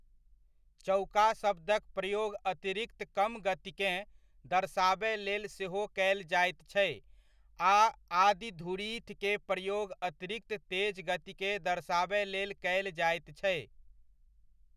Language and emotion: Maithili, neutral